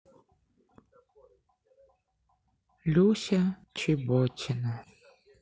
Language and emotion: Russian, sad